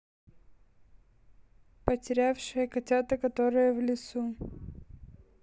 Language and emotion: Russian, neutral